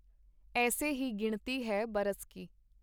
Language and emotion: Punjabi, neutral